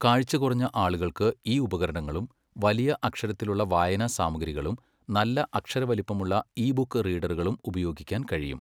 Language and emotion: Malayalam, neutral